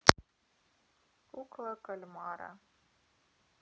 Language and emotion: Russian, neutral